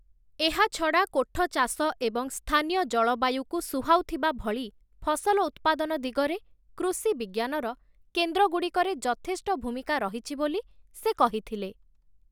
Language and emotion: Odia, neutral